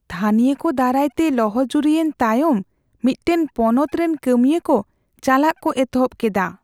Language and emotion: Santali, fearful